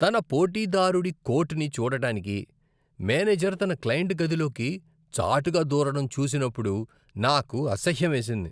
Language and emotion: Telugu, disgusted